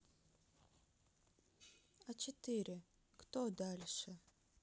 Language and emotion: Russian, sad